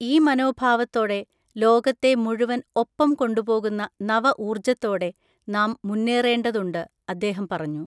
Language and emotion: Malayalam, neutral